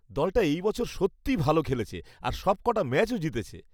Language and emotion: Bengali, happy